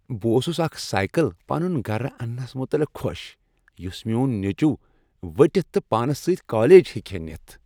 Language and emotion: Kashmiri, happy